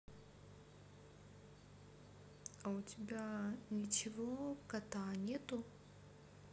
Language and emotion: Russian, neutral